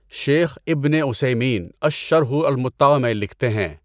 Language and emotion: Urdu, neutral